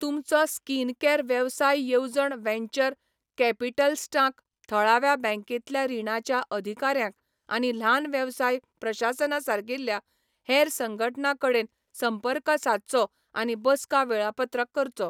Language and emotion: Goan Konkani, neutral